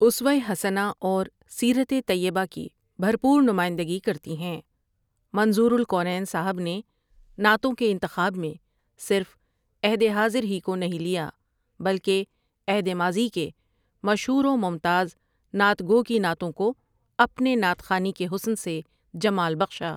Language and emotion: Urdu, neutral